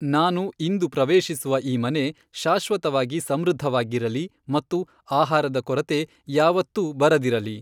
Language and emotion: Kannada, neutral